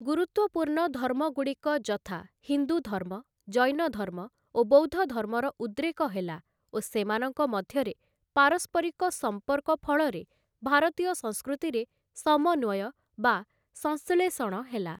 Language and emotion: Odia, neutral